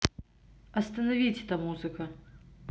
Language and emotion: Russian, neutral